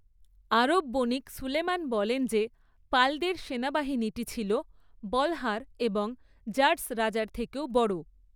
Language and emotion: Bengali, neutral